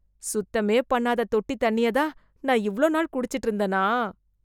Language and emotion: Tamil, disgusted